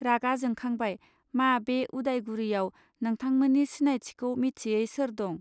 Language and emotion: Bodo, neutral